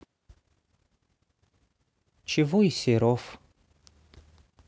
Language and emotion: Russian, neutral